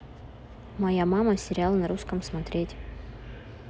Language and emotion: Russian, neutral